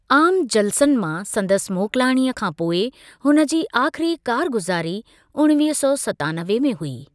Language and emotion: Sindhi, neutral